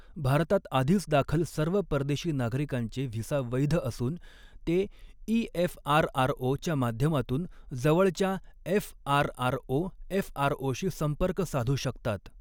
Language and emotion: Marathi, neutral